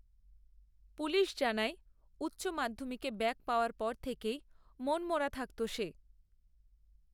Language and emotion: Bengali, neutral